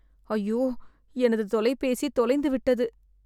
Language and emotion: Tamil, sad